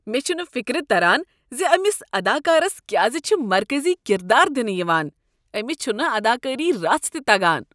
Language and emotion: Kashmiri, disgusted